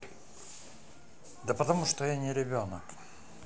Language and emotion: Russian, angry